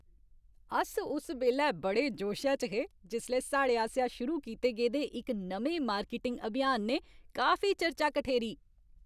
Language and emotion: Dogri, happy